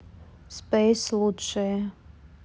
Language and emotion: Russian, neutral